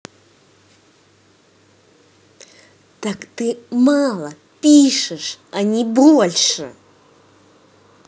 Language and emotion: Russian, angry